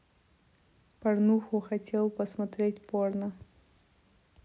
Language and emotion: Russian, neutral